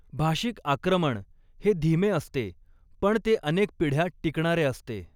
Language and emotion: Marathi, neutral